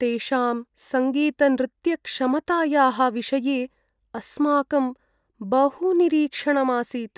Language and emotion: Sanskrit, sad